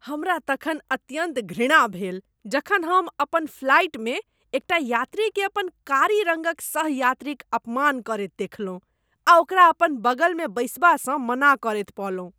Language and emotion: Maithili, disgusted